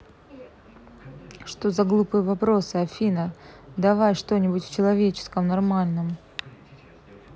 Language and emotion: Russian, neutral